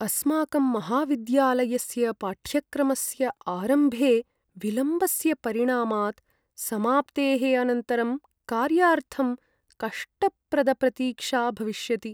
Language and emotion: Sanskrit, sad